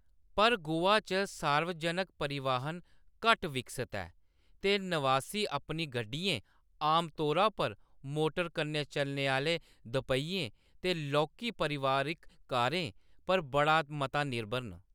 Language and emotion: Dogri, neutral